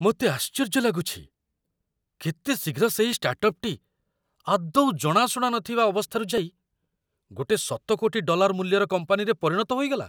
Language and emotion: Odia, surprised